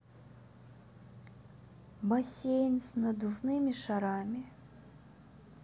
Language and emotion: Russian, sad